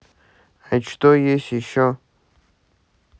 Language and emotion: Russian, neutral